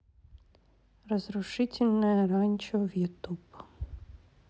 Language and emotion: Russian, neutral